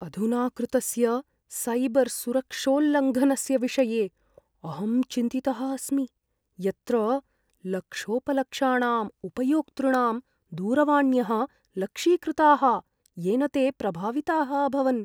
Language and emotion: Sanskrit, fearful